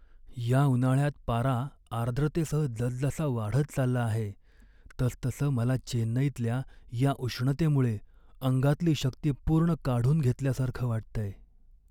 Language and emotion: Marathi, sad